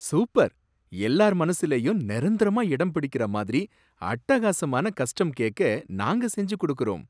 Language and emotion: Tamil, surprised